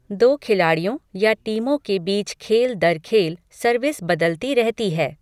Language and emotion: Hindi, neutral